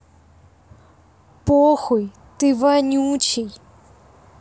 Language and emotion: Russian, neutral